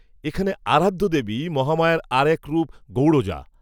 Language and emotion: Bengali, neutral